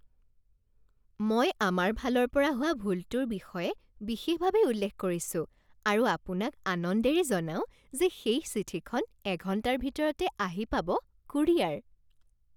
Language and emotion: Assamese, happy